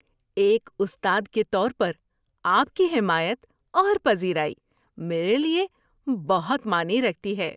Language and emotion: Urdu, happy